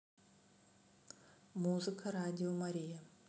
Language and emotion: Russian, neutral